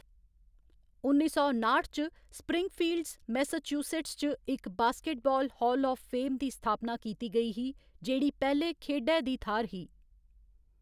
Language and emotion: Dogri, neutral